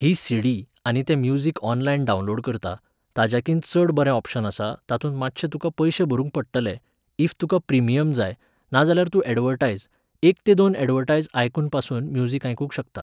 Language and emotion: Goan Konkani, neutral